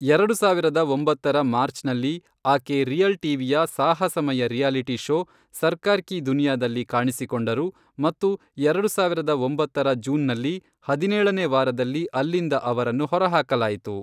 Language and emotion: Kannada, neutral